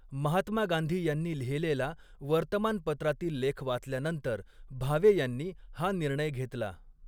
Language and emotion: Marathi, neutral